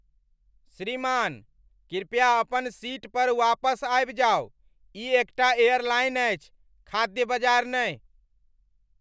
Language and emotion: Maithili, angry